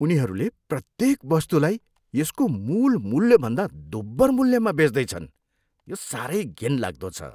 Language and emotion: Nepali, disgusted